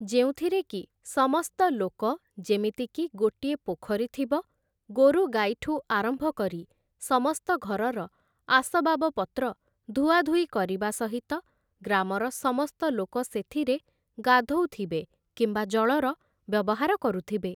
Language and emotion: Odia, neutral